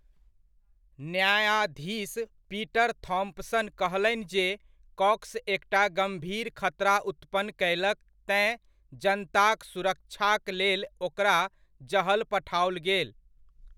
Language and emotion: Maithili, neutral